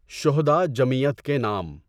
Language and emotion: Urdu, neutral